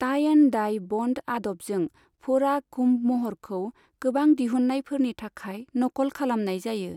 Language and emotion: Bodo, neutral